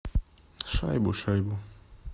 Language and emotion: Russian, neutral